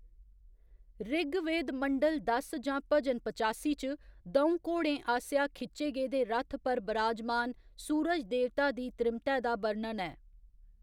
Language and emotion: Dogri, neutral